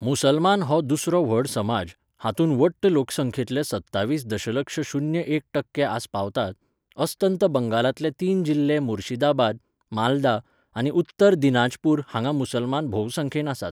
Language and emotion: Goan Konkani, neutral